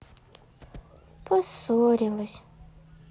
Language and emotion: Russian, sad